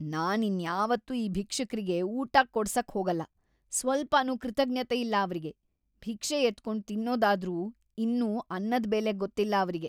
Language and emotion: Kannada, disgusted